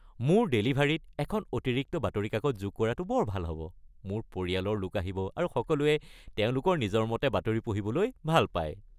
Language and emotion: Assamese, happy